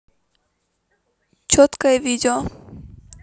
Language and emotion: Russian, neutral